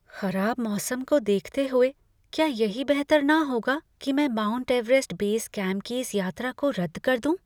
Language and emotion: Hindi, fearful